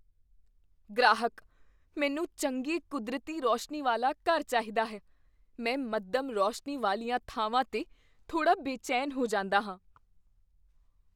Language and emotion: Punjabi, fearful